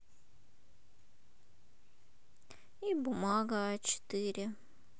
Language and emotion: Russian, sad